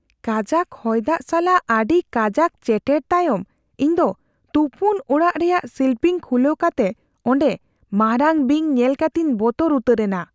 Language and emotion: Santali, fearful